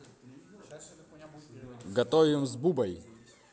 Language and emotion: Russian, positive